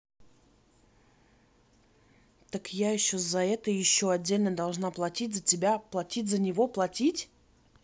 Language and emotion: Russian, angry